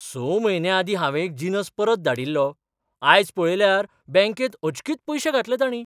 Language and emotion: Goan Konkani, surprised